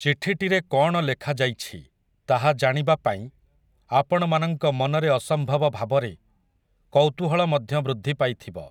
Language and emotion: Odia, neutral